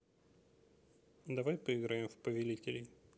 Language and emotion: Russian, neutral